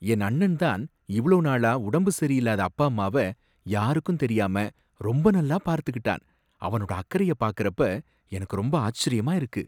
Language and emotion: Tamil, surprised